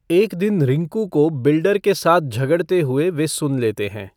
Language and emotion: Hindi, neutral